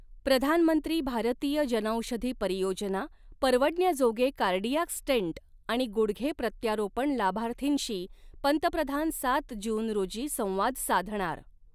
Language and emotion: Marathi, neutral